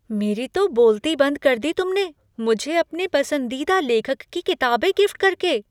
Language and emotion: Hindi, surprised